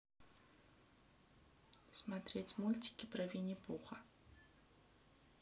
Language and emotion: Russian, neutral